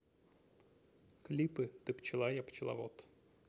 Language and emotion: Russian, neutral